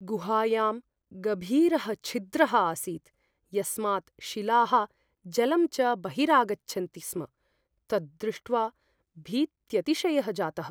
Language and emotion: Sanskrit, fearful